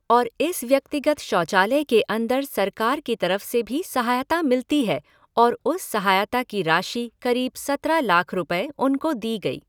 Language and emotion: Hindi, neutral